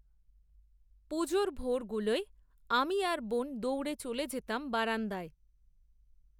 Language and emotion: Bengali, neutral